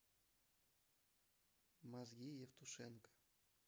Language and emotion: Russian, neutral